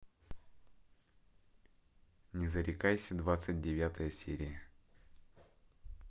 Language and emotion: Russian, neutral